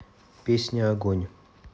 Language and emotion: Russian, neutral